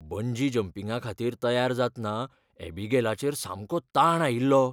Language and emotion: Goan Konkani, fearful